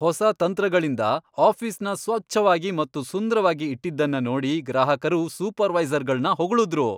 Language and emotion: Kannada, happy